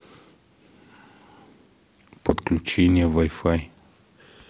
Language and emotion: Russian, neutral